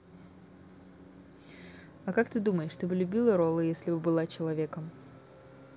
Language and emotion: Russian, neutral